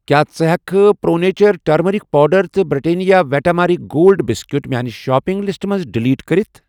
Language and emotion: Kashmiri, neutral